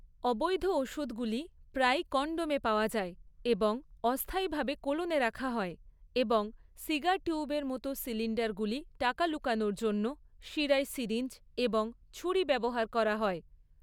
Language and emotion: Bengali, neutral